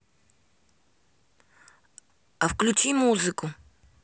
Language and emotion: Russian, neutral